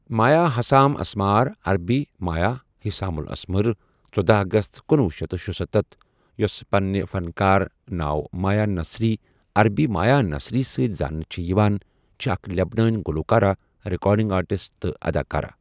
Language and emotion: Kashmiri, neutral